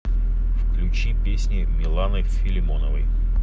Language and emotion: Russian, neutral